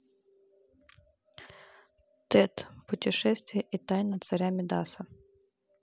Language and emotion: Russian, neutral